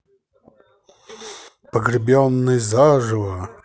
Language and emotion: Russian, positive